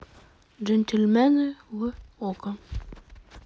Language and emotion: Russian, neutral